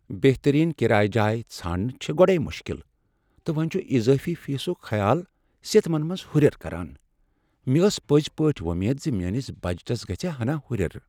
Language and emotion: Kashmiri, sad